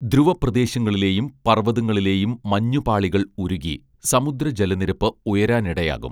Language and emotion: Malayalam, neutral